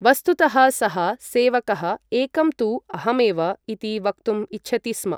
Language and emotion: Sanskrit, neutral